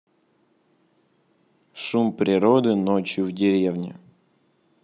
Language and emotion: Russian, neutral